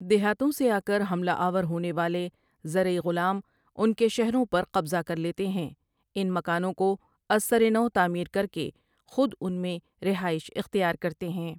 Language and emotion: Urdu, neutral